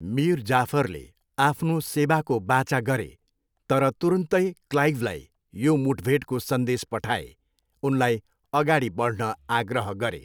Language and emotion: Nepali, neutral